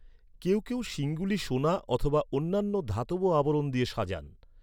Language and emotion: Bengali, neutral